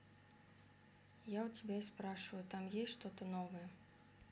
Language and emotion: Russian, sad